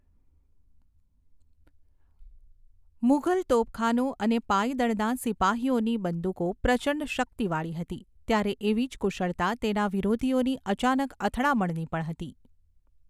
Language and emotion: Gujarati, neutral